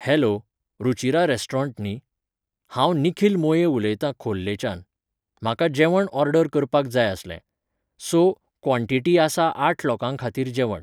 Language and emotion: Goan Konkani, neutral